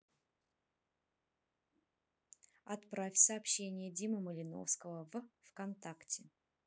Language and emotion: Russian, neutral